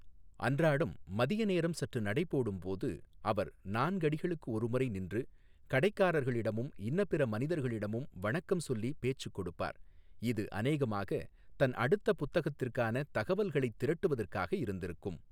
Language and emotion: Tamil, neutral